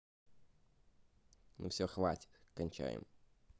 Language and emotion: Russian, neutral